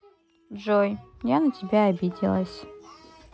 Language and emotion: Russian, sad